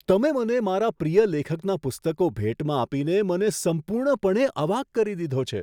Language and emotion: Gujarati, surprised